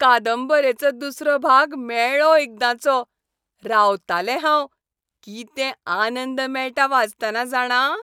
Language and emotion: Goan Konkani, happy